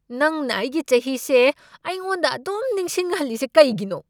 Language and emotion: Manipuri, angry